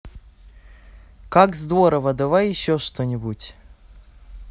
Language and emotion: Russian, positive